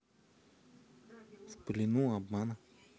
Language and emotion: Russian, neutral